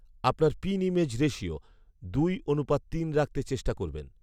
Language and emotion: Bengali, neutral